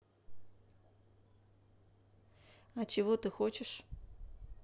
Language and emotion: Russian, neutral